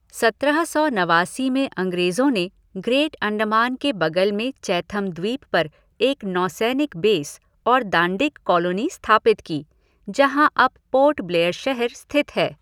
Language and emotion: Hindi, neutral